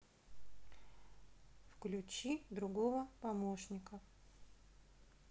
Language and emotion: Russian, neutral